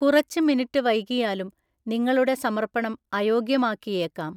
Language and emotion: Malayalam, neutral